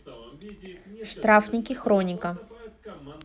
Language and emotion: Russian, neutral